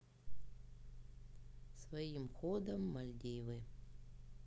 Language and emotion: Russian, sad